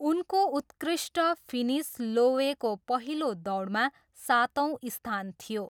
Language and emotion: Nepali, neutral